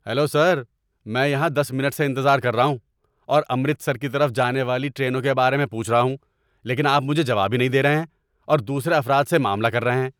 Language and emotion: Urdu, angry